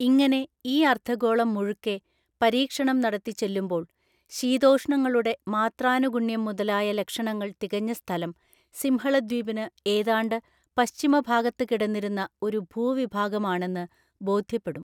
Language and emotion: Malayalam, neutral